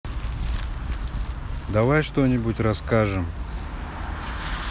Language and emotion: Russian, neutral